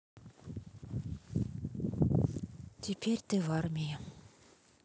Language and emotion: Russian, sad